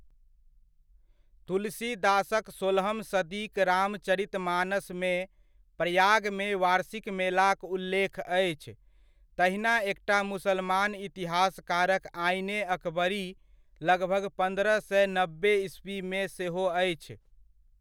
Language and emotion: Maithili, neutral